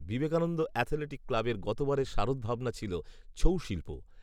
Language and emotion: Bengali, neutral